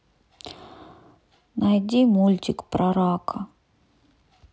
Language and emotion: Russian, neutral